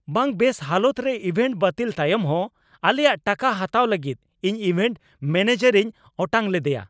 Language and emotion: Santali, angry